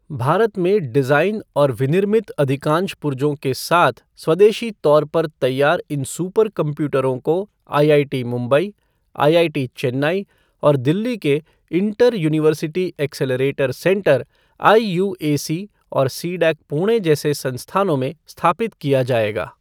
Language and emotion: Hindi, neutral